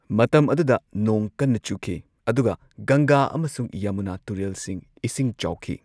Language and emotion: Manipuri, neutral